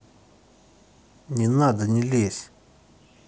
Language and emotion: Russian, angry